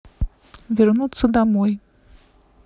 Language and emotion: Russian, neutral